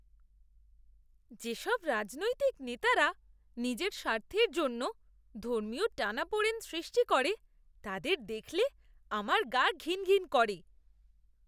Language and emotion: Bengali, disgusted